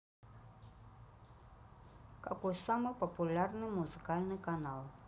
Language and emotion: Russian, neutral